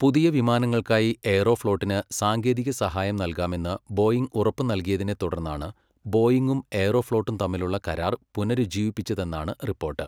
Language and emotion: Malayalam, neutral